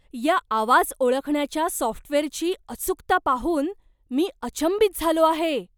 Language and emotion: Marathi, surprised